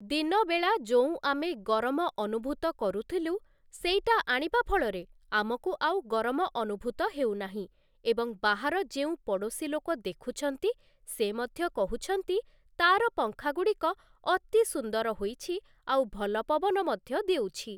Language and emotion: Odia, neutral